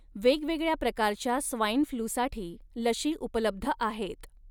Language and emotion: Marathi, neutral